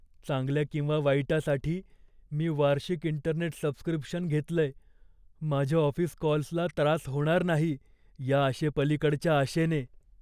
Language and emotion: Marathi, fearful